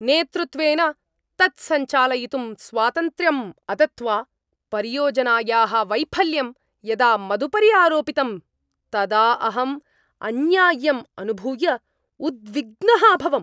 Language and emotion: Sanskrit, angry